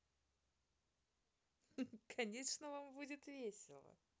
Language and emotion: Russian, positive